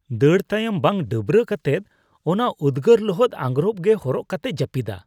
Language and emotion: Santali, disgusted